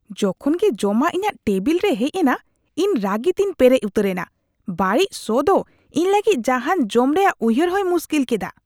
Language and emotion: Santali, disgusted